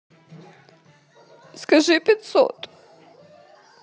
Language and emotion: Russian, sad